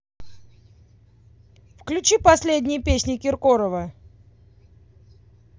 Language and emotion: Russian, angry